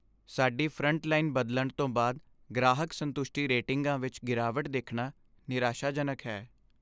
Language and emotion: Punjabi, sad